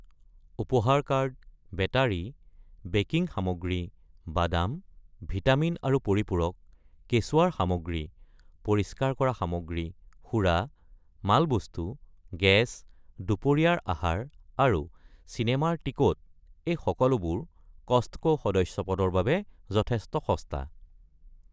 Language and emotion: Assamese, neutral